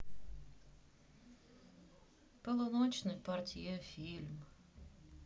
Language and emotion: Russian, sad